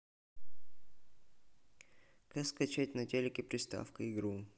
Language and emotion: Russian, neutral